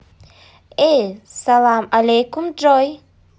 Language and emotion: Russian, positive